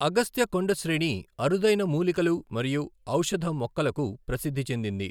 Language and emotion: Telugu, neutral